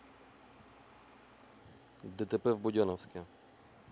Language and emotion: Russian, neutral